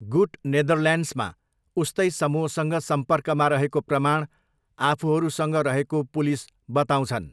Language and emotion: Nepali, neutral